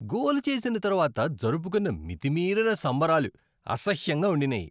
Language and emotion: Telugu, disgusted